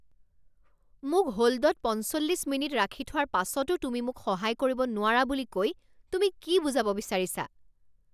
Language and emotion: Assamese, angry